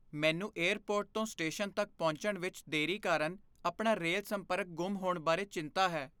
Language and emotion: Punjabi, fearful